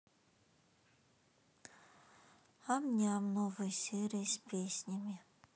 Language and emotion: Russian, sad